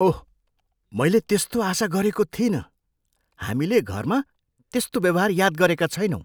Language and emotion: Nepali, surprised